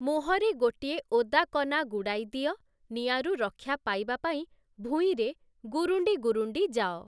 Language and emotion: Odia, neutral